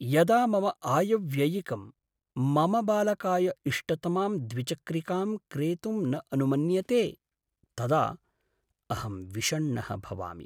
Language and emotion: Sanskrit, sad